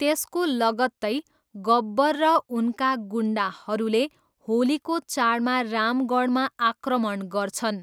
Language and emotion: Nepali, neutral